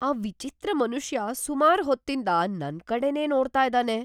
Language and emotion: Kannada, fearful